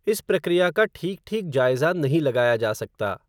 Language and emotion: Hindi, neutral